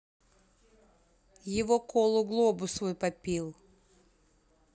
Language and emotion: Russian, neutral